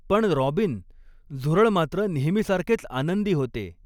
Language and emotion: Marathi, neutral